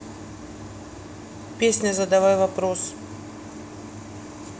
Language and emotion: Russian, neutral